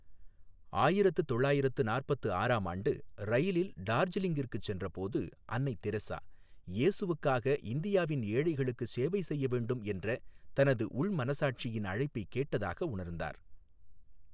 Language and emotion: Tamil, neutral